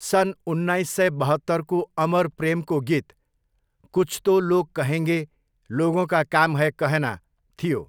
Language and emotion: Nepali, neutral